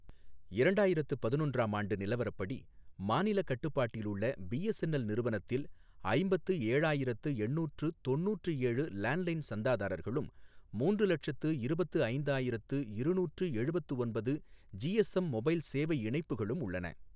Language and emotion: Tamil, neutral